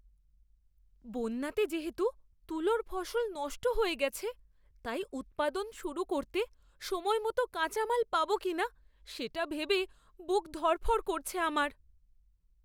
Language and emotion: Bengali, fearful